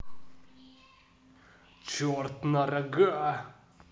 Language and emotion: Russian, neutral